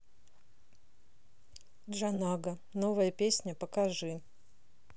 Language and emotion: Russian, neutral